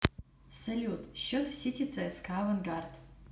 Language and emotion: Russian, positive